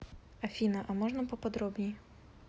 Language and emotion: Russian, neutral